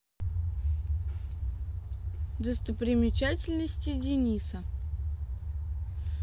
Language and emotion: Russian, neutral